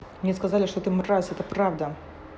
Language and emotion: Russian, angry